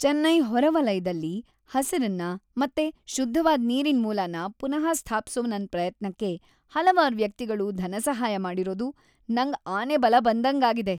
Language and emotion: Kannada, happy